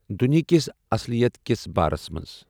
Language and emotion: Kashmiri, neutral